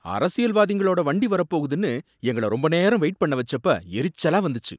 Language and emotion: Tamil, angry